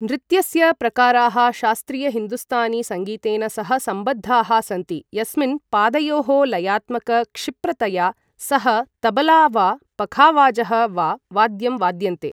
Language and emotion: Sanskrit, neutral